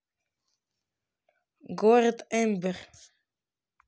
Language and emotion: Russian, neutral